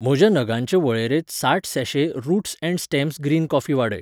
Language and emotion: Goan Konkani, neutral